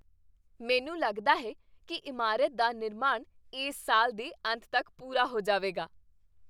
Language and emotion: Punjabi, happy